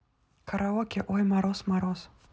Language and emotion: Russian, neutral